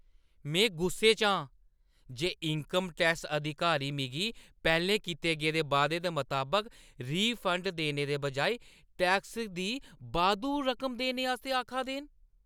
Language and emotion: Dogri, angry